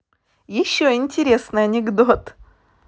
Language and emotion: Russian, positive